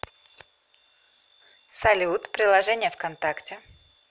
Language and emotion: Russian, positive